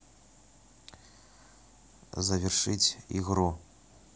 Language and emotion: Russian, neutral